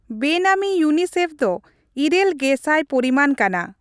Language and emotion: Santali, neutral